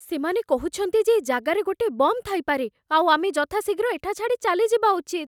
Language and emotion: Odia, fearful